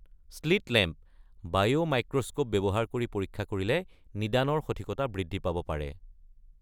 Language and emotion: Assamese, neutral